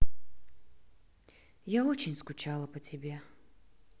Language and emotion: Russian, sad